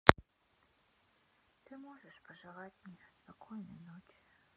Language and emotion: Russian, sad